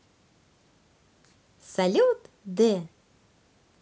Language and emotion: Russian, positive